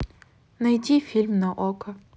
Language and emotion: Russian, neutral